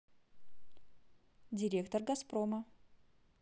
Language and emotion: Russian, positive